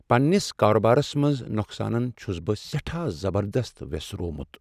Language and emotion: Kashmiri, sad